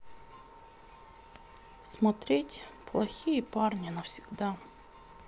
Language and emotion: Russian, sad